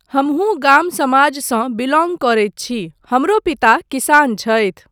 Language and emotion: Maithili, neutral